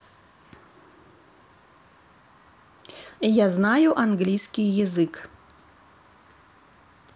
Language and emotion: Russian, neutral